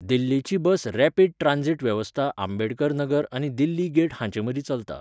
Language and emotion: Goan Konkani, neutral